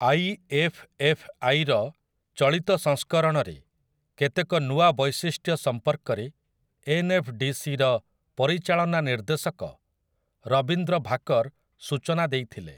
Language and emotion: Odia, neutral